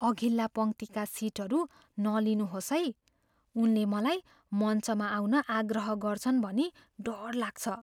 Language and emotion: Nepali, fearful